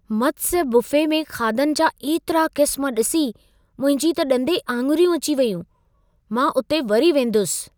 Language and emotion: Sindhi, surprised